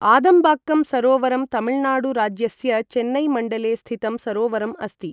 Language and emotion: Sanskrit, neutral